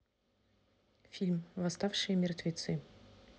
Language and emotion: Russian, neutral